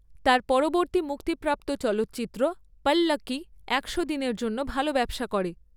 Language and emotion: Bengali, neutral